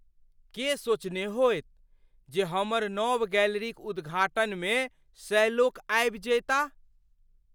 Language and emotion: Maithili, surprised